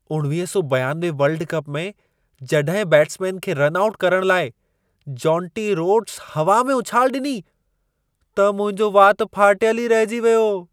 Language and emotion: Sindhi, surprised